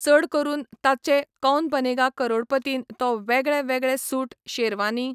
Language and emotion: Goan Konkani, neutral